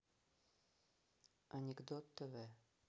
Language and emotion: Russian, neutral